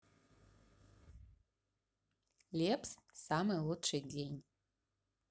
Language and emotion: Russian, neutral